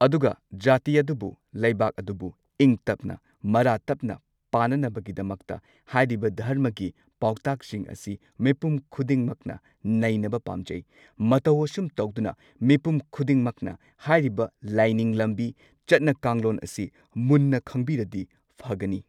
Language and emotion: Manipuri, neutral